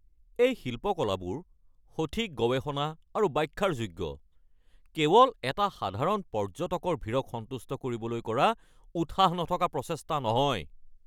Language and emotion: Assamese, angry